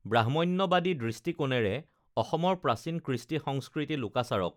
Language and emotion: Assamese, neutral